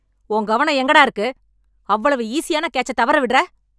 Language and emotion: Tamil, angry